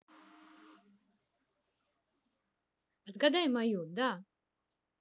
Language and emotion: Russian, positive